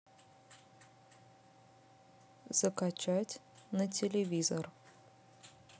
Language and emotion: Russian, neutral